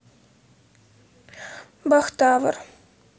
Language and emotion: Russian, sad